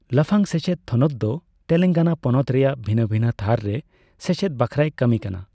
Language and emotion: Santali, neutral